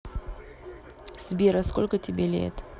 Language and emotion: Russian, neutral